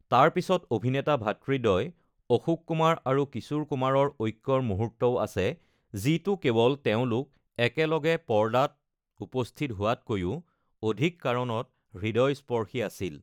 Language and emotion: Assamese, neutral